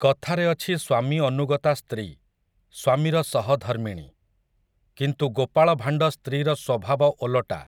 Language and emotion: Odia, neutral